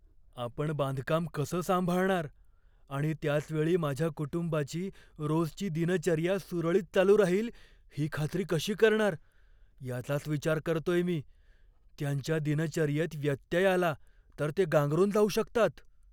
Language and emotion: Marathi, fearful